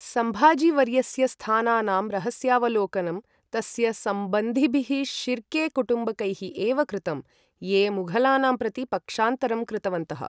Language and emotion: Sanskrit, neutral